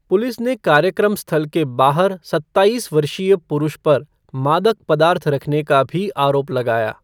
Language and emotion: Hindi, neutral